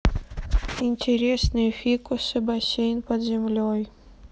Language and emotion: Russian, sad